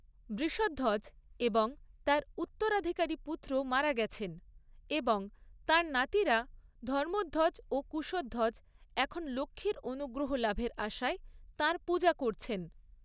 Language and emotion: Bengali, neutral